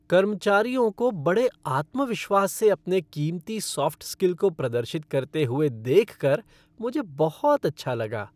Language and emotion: Hindi, happy